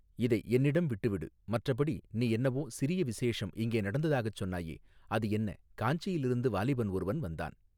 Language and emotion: Tamil, neutral